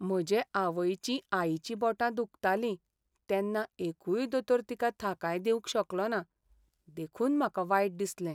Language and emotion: Goan Konkani, sad